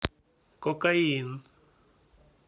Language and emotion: Russian, neutral